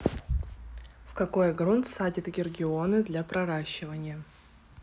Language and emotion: Russian, neutral